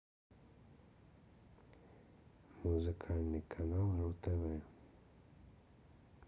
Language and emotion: Russian, neutral